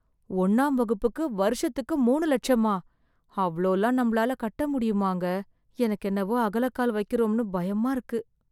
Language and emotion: Tamil, fearful